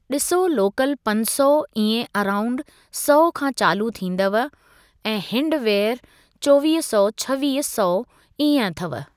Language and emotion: Sindhi, neutral